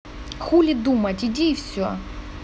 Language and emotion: Russian, neutral